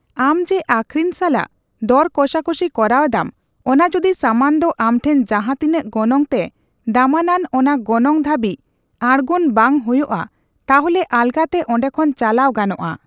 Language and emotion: Santali, neutral